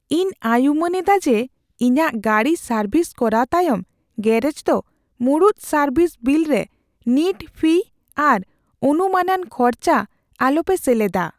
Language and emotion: Santali, fearful